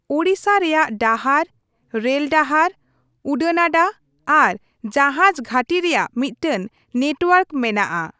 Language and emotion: Santali, neutral